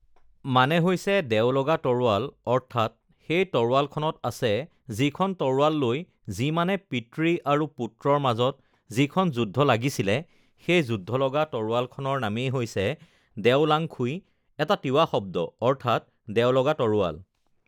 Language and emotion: Assamese, neutral